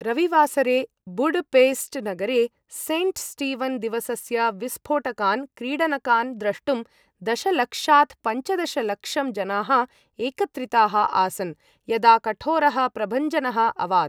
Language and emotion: Sanskrit, neutral